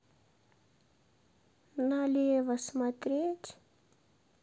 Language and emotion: Russian, sad